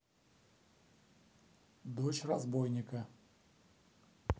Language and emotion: Russian, neutral